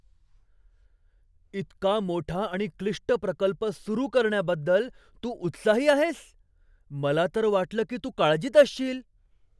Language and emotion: Marathi, surprised